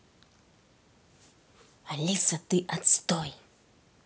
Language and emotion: Russian, angry